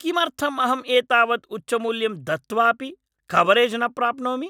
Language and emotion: Sanskrit, angry